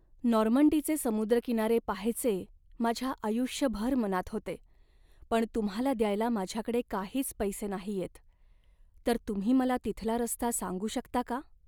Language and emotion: Marathi, sad